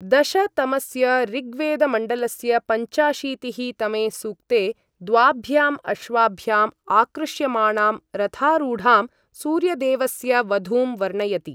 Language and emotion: Sanskrit, neutral